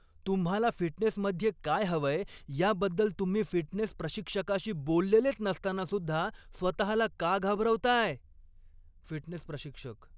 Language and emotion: Marathi, angry